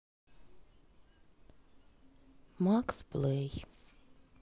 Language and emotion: Russian, sad